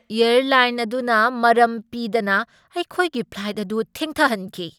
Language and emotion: Manipuri, angry